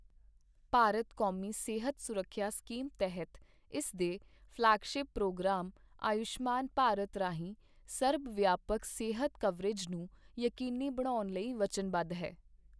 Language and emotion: Punjabi, neutral